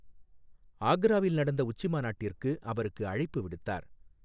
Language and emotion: Tamil, neutral